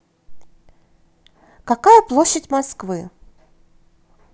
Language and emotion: Russian, positive